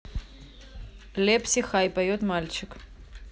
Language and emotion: Russian, neutral